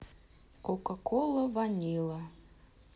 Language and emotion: Russian, neutral